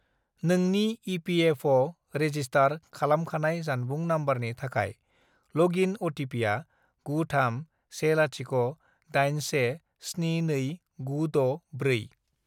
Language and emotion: Bodo, neutral